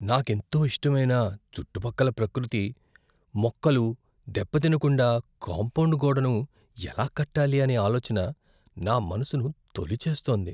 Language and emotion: Telugu, fearful